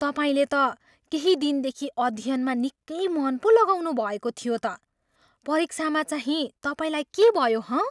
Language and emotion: Nepali, surprised